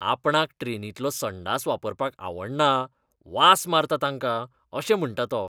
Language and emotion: Goan Konkani, disgusted